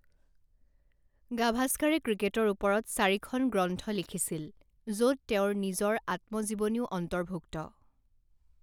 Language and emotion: Assamese, neutral